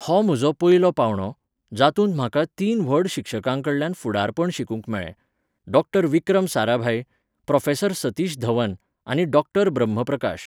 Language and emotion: Goan Konkani, neutral